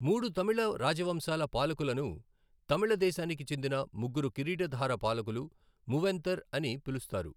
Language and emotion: Telugu, neutral